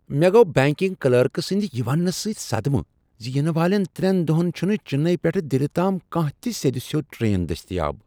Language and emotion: Kashmiri, surprised